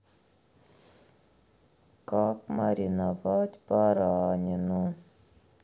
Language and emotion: Russian, sad